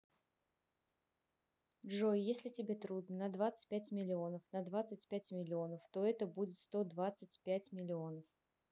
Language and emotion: Russian, neutral